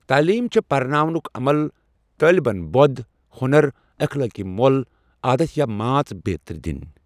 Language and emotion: Kashmiri, neutral